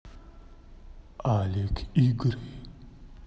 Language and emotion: Russian, neutral